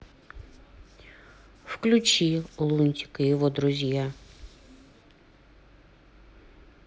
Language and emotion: Russian, neutral